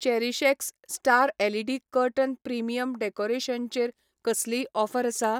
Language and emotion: Goan Konkani, neutral